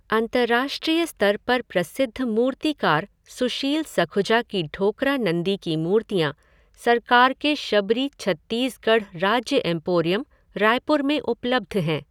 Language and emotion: Hindi, neutral